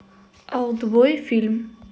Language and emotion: Russian, neutral